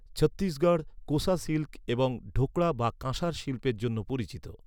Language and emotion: Bengali, neutral